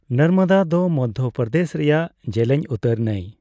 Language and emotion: Santali, neutral